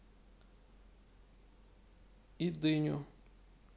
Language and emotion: Russian, neutral